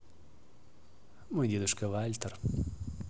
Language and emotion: Russian, neutral